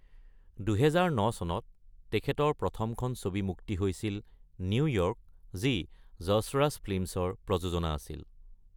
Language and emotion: Assamese, neutral